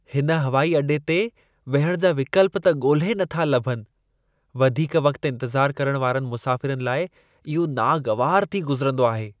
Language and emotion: Sindhi, disgusted